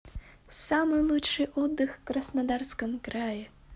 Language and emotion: Russian, positive